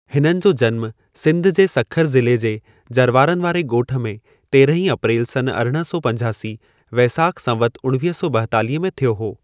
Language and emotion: Sindhi, neutral